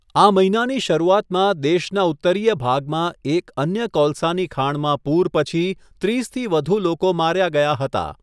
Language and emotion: Gujarati, neutral